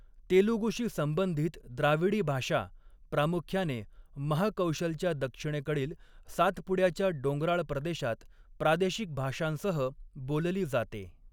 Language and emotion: Marathi, neutral